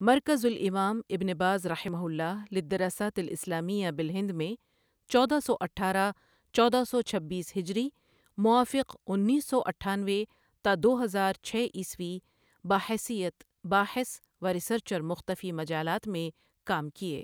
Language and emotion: Urdu, neutral